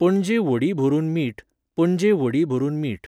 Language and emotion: Goan Konkani, neutral